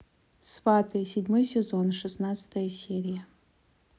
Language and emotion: Russian, neutral